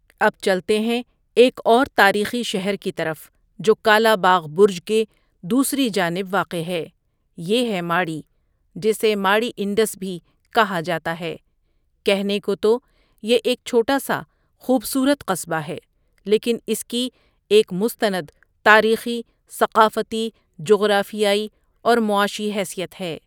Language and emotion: Urdu, neutral